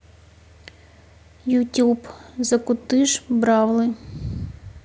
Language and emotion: Russian, neutral